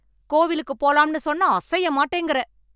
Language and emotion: Tamil, angry